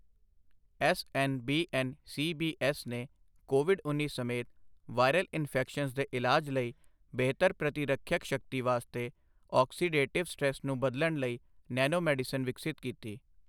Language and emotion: Punjabi, neutral